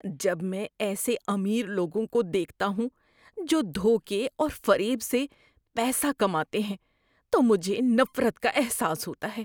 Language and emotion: Urdu, disgusted